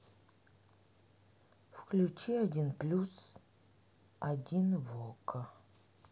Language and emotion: Russian, sad